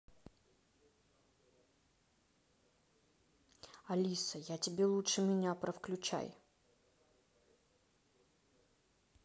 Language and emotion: Russian, neutral